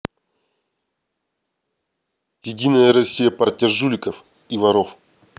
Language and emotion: Russian, angry